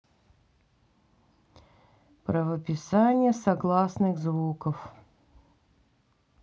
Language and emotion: Russian, neutral